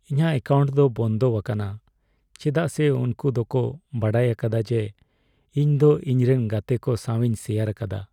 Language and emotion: Santali, sad